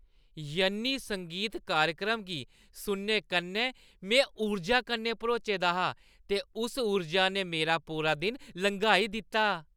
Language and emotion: Dogri, happy